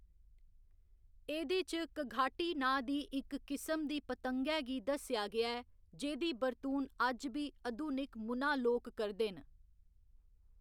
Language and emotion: Dogri, neutral